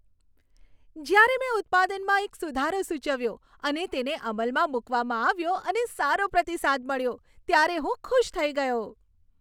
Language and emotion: Gujarati, happy